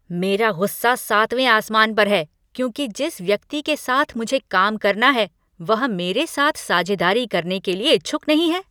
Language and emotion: Hindi, angry